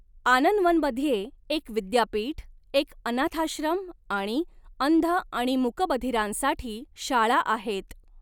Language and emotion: Marathi, neutral